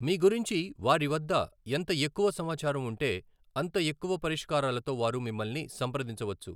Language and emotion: Telugu, neutral